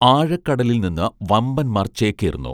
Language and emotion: Malayalam, neutral